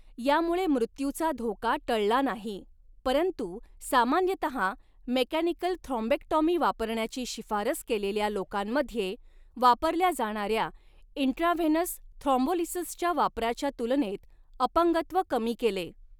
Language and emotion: Marathi, neutral